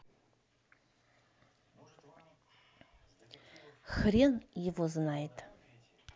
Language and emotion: Russian, angry